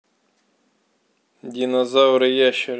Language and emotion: Russian, neutral